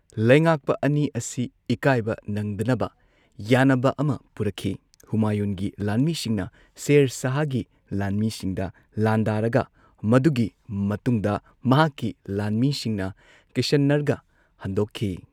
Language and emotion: Manipuri, neutral